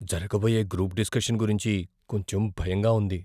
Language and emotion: Telugu, fearful